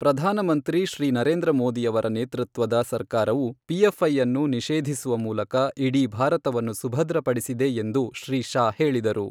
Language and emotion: Kannada, neutral